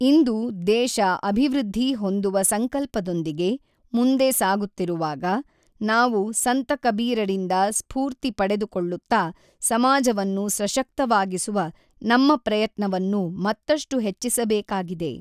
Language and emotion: Kannada, neutral